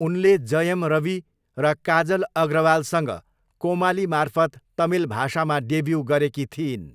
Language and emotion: Nepali, neutral